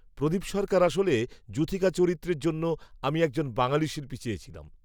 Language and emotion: Bengali, neutral